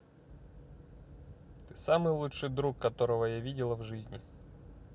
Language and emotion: Russian, positive